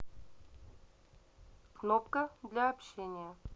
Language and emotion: Russian, neutral